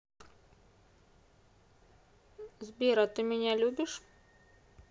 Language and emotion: Russian, neutral